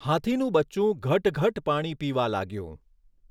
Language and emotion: Gujarati, neutral